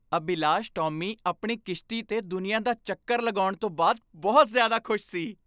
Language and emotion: Punjabi, happy